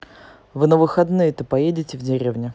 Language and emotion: Russian, neutral